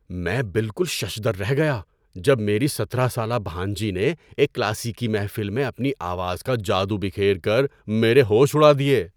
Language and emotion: Urdu, surprised